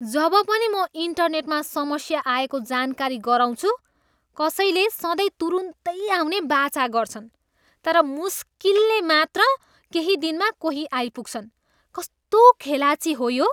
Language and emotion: Nepali, disgusted